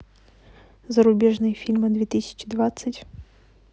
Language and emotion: Russian, neutral